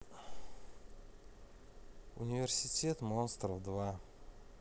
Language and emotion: Russian, neutral